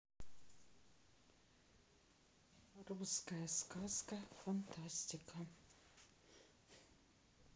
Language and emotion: Russian, neutral